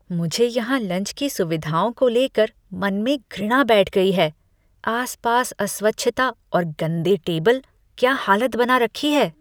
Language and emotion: Hindi, disgusted